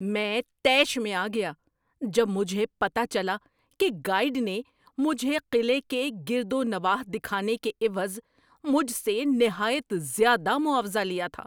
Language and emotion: Urdu, angry